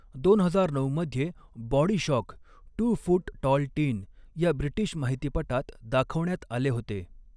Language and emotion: Marathi, neutral